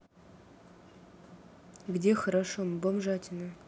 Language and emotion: Russian, neutral